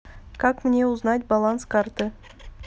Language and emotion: Russian, neutral